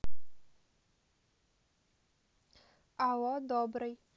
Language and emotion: Russian, neutral